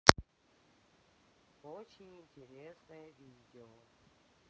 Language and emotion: Russian, neutral